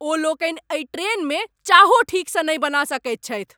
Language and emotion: Maithili, angry